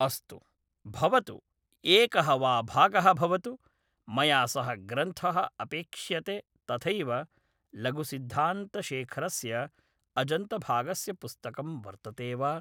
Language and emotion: Sanskrit, neutral